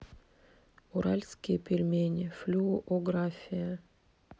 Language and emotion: Russian, neutral